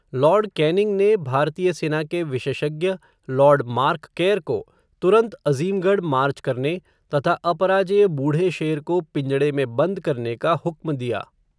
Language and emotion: Hindi, neutral